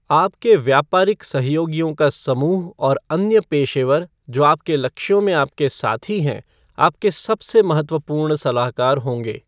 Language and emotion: Hindi, neutral